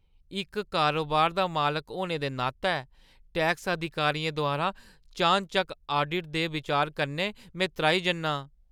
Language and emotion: Dogri, fearful